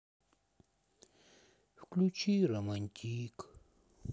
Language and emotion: Russian, sad